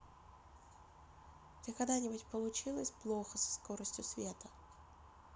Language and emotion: Russian, neutral